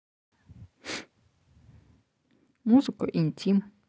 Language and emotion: Russian, neutral